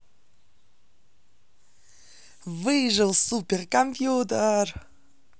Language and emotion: Russian, positive